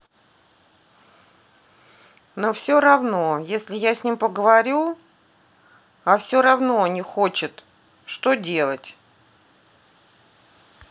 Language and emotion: Russian, sad